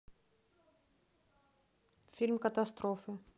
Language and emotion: Russian, neutral